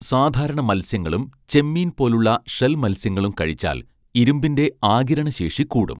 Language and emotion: Malayalam, neutral